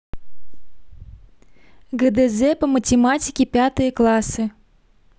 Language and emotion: Russian, neutral